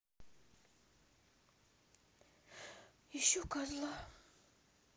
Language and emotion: Russian, sad